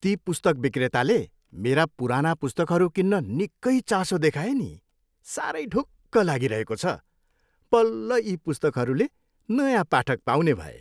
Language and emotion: Nepali, happy